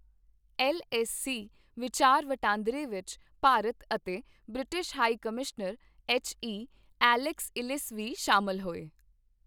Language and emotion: Punjabi, neutral